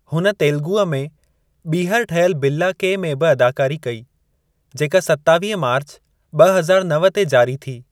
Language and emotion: Sindhi, neutral